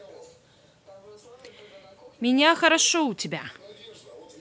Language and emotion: Russian, neutral